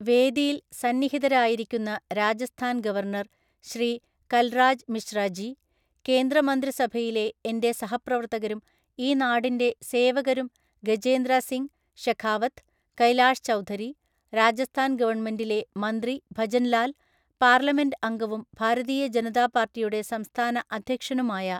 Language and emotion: Malayalam, neutral